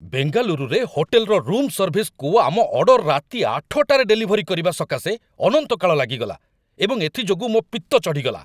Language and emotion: Odia, angry